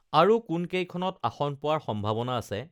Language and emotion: Assamese, neutral